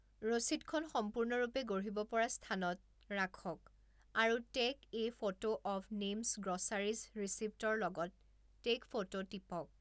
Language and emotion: Assamese, neutral